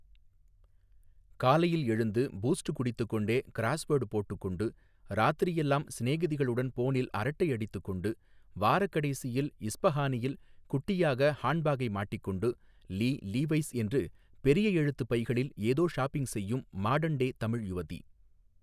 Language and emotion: Tamil, neutral